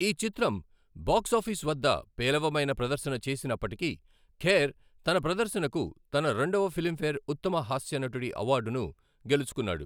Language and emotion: Telugu, neutral